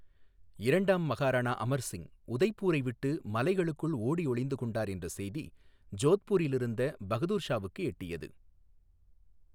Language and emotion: Tamil, neutral